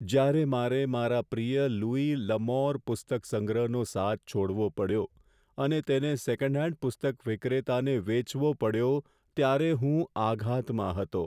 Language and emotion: Gujarati, sad